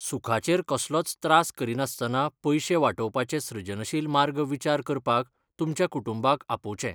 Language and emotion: Goan Konkani, neutral